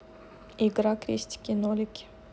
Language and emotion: Russian, neutral